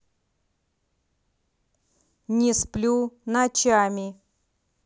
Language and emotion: Russian, angry